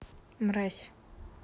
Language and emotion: Russian, neutral